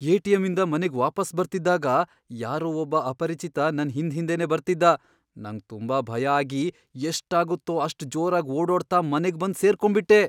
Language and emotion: Kannada, fearful